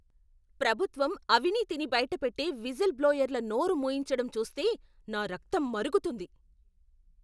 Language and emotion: Telugu, angry